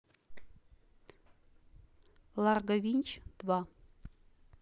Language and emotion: Russian, neutral